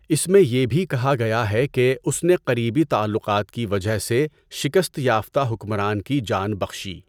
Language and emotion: Urdu, neutral